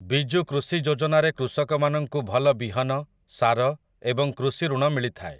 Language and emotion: Odia, neutral